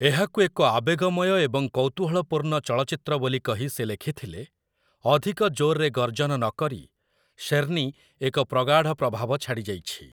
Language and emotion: Odia, neutral